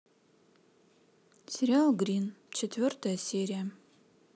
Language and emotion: Russian, neutral